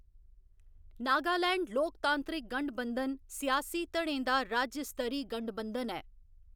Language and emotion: Dogri, neutral